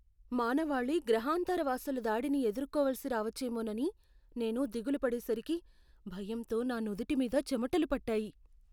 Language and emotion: Telugu, fearful